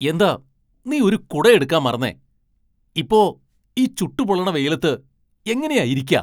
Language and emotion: Malayalam, angry